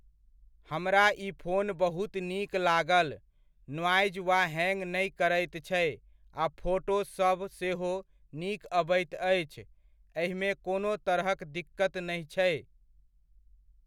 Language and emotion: Maithili, neutral